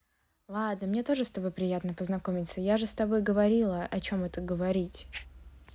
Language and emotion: Russian, neutral